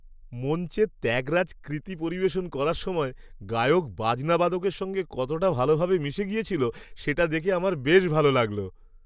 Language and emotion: Bengali, happy